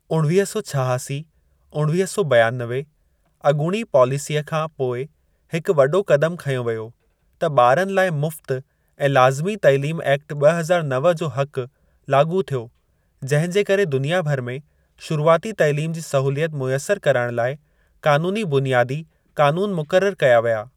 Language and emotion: Sindhi, neutral